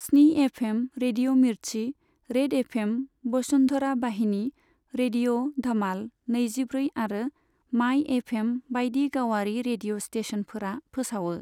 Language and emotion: Bodo, neutral